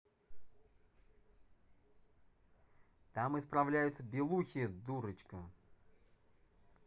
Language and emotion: Russian, neutral